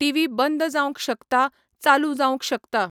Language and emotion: Goan Konkani, neutral